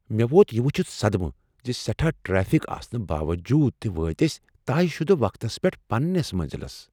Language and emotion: Kashmiri, surprised